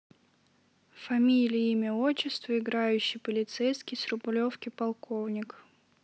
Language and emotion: Russian, neutral